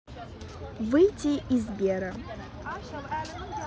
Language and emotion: Russian, neutral